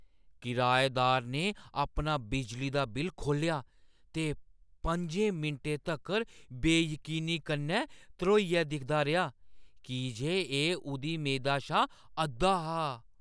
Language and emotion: Dogri, surprised